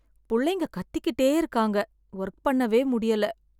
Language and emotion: Tamil, sad